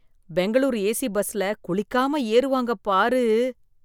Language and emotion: Tamil, disgusted